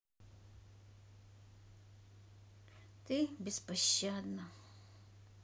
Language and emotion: Russian, sad